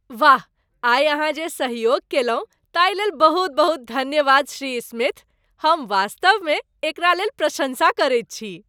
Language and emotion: Maithili, happy